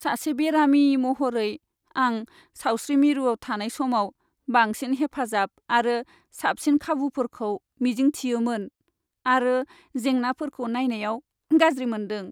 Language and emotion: Bodo, sad